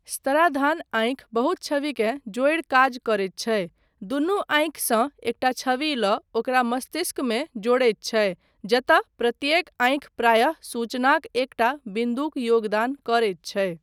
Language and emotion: Maithili, neutral